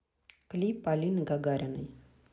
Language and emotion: Russian, neutral